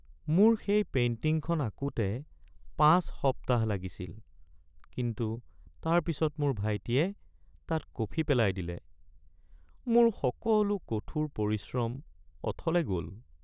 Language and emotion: Assamese, sad